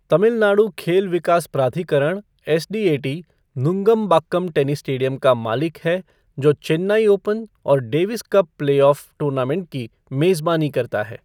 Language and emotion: Hindi, neutral